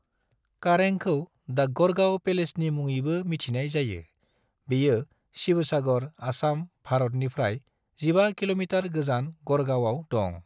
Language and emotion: Bodo, neutral